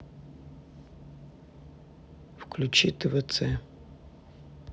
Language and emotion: Russian, neutral